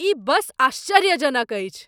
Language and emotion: Maithili, surprised